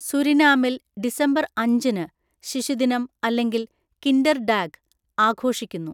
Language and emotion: Malayalam, neutral